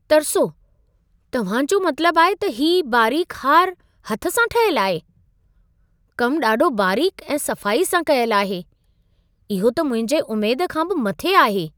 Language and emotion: Sindhi, surprised